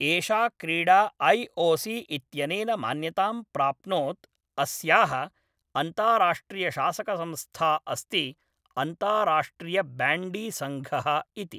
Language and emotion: Sanskrit, neutral